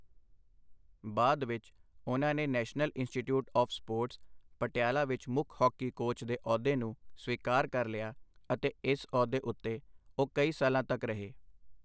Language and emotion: Punjabi, neutral